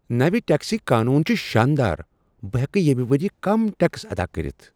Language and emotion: Kashmiri, surprised